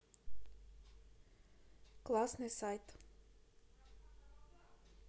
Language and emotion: Russian, neutral